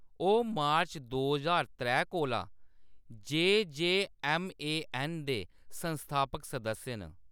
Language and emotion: Dogri, neutral